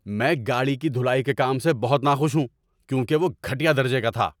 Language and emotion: Urdu, angry